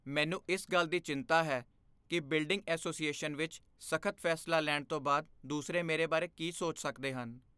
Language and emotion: Punjabi, fearful